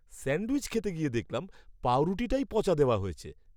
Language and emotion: Bengali, disgusted